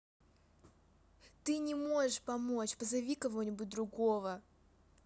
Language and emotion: Russian, angry